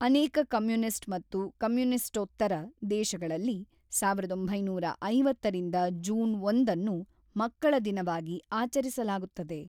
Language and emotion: Kannada, neutral